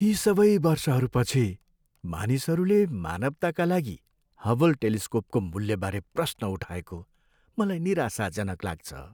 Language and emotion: Nepali, sad